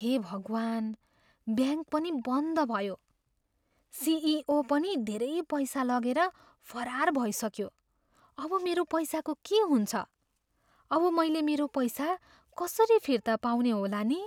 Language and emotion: Nepali, fearful